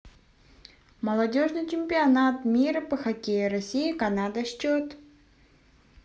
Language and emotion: Russian, neutral